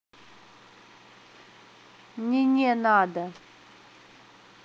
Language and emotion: Russian, neutral